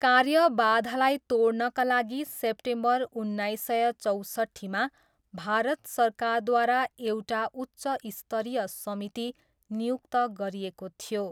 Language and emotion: Nepali, neutral